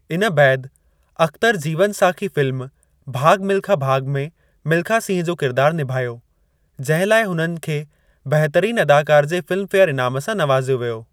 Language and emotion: Sindhi, neutral